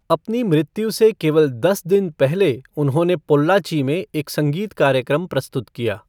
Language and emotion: Hindi, neutral